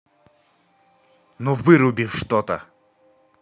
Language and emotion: Russian, angry